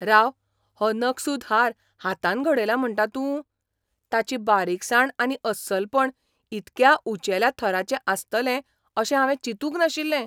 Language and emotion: Goan Konkani, surprised